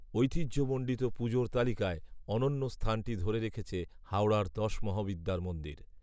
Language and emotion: Bengali, neutral